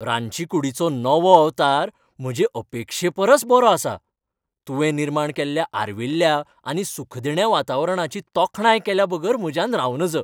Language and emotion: Goan Konkani, happy